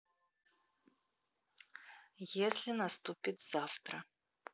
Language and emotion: Russian, neutral